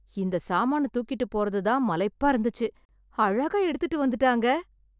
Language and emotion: Tamil, surprised